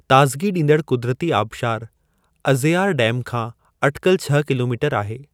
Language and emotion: Sindhi, neutral